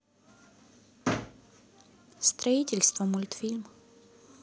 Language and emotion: Russian, neutral